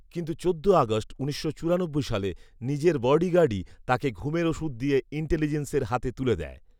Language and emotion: Bengali, neutral